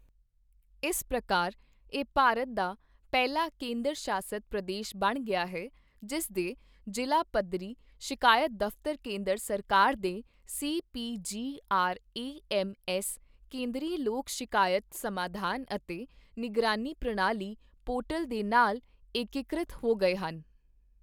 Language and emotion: Punjabi, neutral